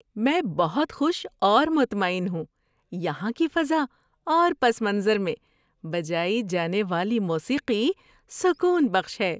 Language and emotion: Urdu, happy